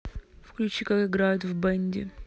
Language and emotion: Russian, neutral